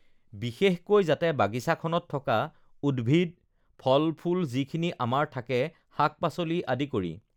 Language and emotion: Assamese, neutral